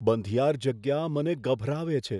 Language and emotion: Gujarati, fearful